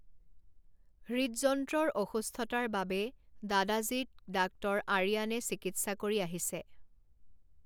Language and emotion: Assamese, neutral